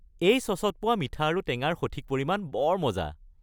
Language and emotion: Assamese, happy